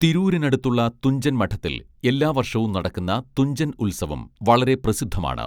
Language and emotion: Malayalam, neutral